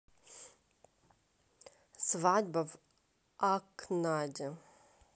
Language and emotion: Russian, neutral